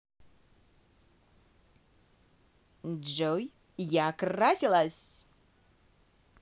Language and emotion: Russian, positive